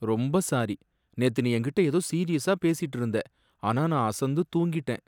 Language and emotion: Tamil, sad